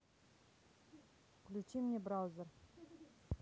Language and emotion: Russian, neutral